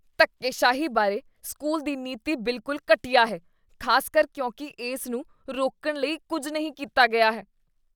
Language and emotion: Punjabi, disgusted